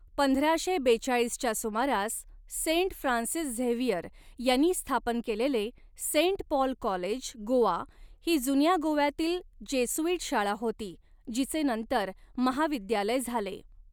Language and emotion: Marathi, neutral